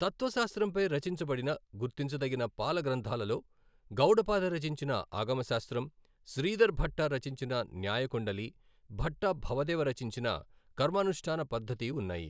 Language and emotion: Telugu, neutral